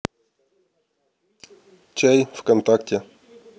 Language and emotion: Russian, neutral